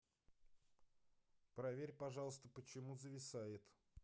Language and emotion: Russian, neutral